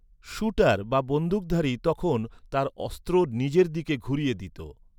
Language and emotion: Bengali, neutral